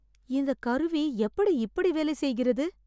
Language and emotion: Tamil, surprised